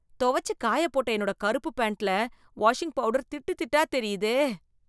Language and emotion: Tamil, disgusted